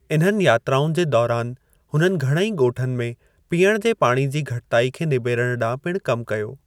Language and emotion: Sindhi, neutral